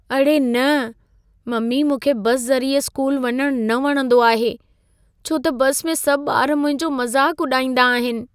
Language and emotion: Sindhi, fearful